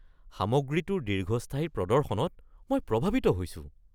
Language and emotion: Assamese, surprised